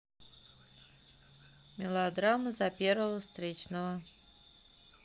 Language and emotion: Russian, neutral